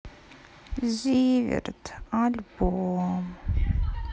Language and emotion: Russian, sad